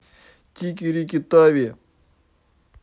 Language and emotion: Russian, neutral